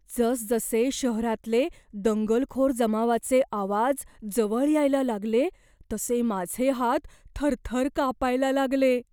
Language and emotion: Marathi, fearful